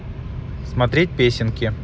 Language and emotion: Russian, neutral